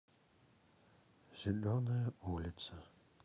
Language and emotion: Russian, neutral